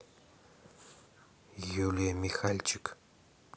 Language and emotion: Russian, neutral